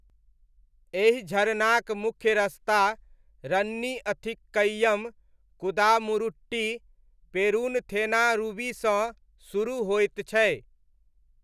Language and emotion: Maithili, neutral